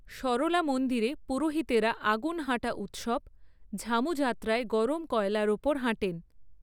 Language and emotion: Bengali, neutral